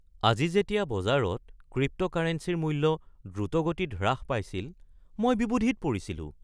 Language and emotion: Assamese, surprised